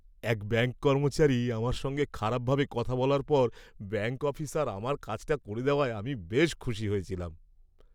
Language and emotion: Bengali, happy